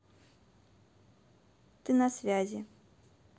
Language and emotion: Russian, neutral